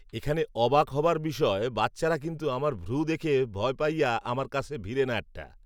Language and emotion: Bengali, neutral